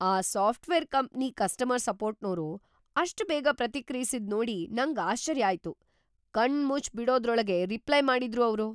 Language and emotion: Kannada, surprised